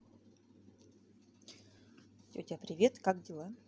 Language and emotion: Russian, neutral